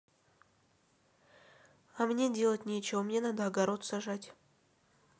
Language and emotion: Russian, neutral